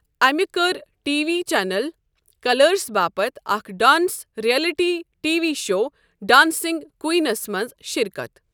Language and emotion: Kashmiri, neutral